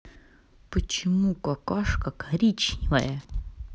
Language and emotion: Russian, neutral